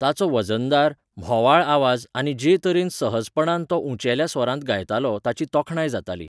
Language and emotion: Goan Konkani, neutral